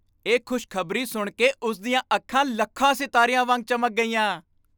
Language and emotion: Punjabi, happy